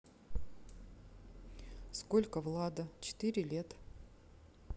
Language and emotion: Russian, neutral